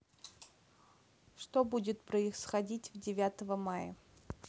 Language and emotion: Russian, neutral